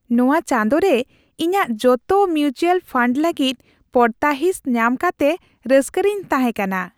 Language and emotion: Santali, happy